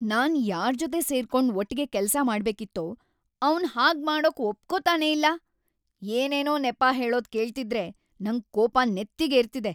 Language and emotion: Kannada, angry